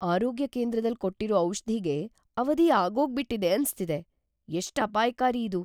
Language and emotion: Kannada, fearful